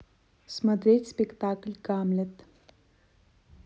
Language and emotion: Russian, neutral